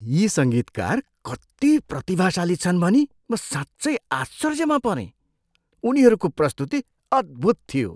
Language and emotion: Nepali, surprised